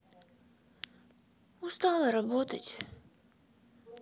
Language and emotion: Russian, sad